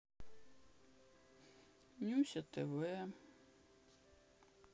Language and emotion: Russian, sad